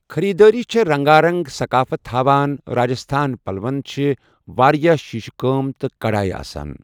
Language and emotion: Kashmiri, neutral